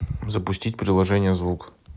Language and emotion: Russian, neutral